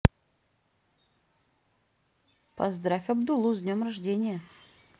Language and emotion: Russian, neutral